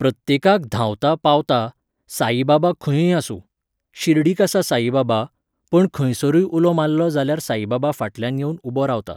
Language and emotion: Goan Konkani, neutral